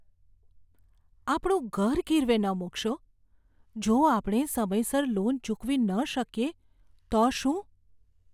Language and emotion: Gujarati, fearful